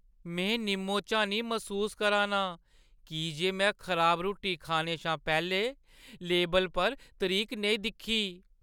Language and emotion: Dogri, sad